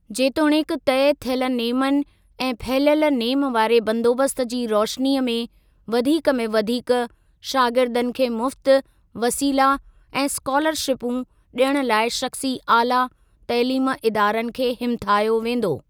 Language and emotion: Sindhi, neutral